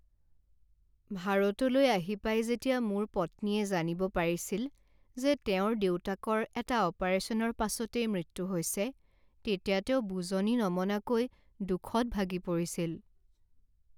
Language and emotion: Assamese, sad